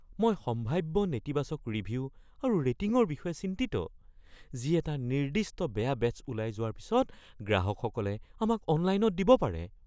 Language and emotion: Assamese, fearful